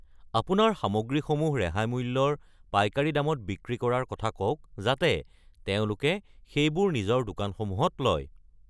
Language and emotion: Assamese, neutral